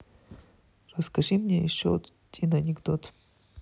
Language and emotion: Russian, neutral